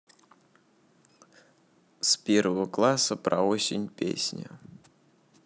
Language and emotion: Russian, neutral